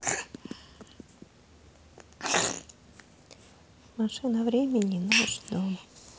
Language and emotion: Russian, sad